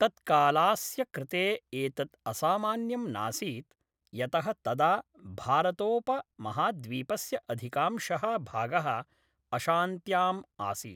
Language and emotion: Sanskrit, neutral